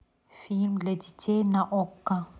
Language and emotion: Russian, neutral